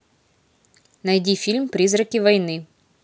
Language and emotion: Russian, neutral